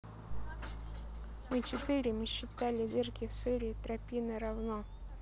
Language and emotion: Russian, neutral